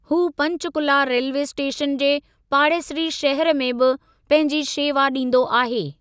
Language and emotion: Sindhi, neutral